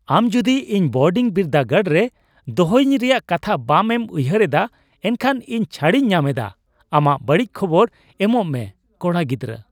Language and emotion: Santali, happy